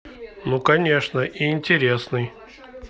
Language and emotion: Russian, neutral